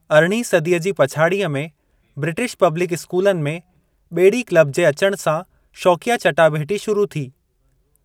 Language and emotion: Sindhi, neutral